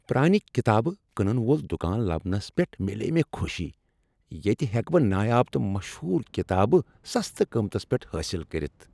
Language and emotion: Kashmiri, happy